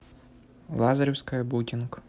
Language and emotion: Russian, neutral